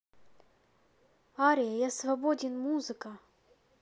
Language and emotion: Russian, neutral